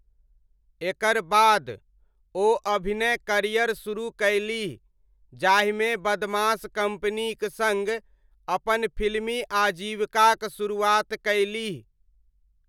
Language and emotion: Maithili, neutral